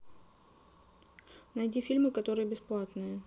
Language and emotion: Russian, neutral